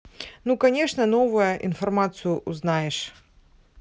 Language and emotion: Russian, neutral